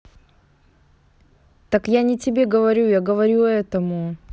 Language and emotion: Russian, neutral